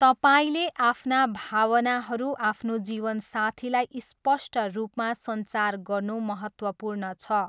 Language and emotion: Nepali, neutral